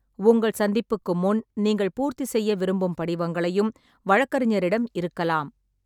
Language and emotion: Tamil, neutral